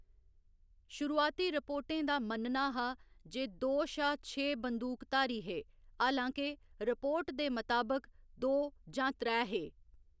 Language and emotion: Dogri, neutral